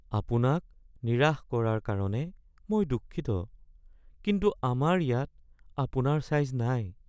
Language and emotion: Assamese, sad